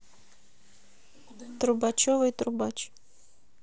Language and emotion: Russian, neutral